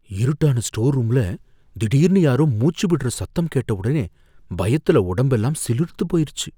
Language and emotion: Tamil, fearful